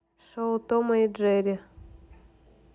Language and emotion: Russian, neutral